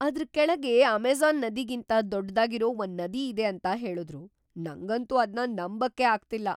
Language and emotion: Kannada, surprised